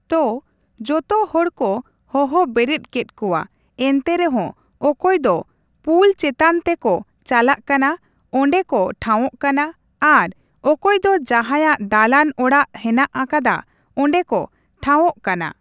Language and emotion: Santali, neutral